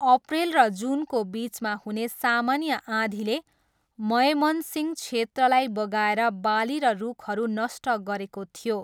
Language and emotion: Nepali, neutral